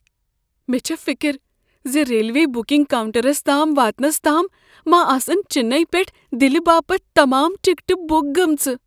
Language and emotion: Kashmiri, fearful